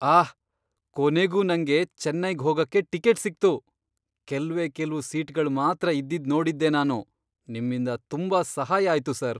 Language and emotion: Kannada, surprised